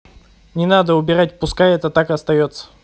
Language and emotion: Russian, neutral